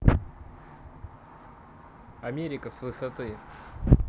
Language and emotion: Russian, neutral